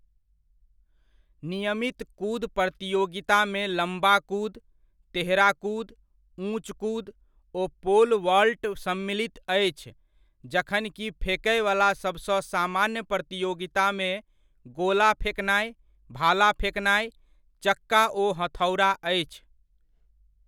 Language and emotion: Maithili, neutral